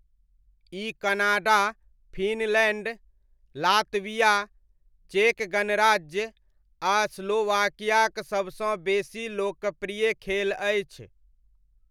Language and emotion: Maithili, neutral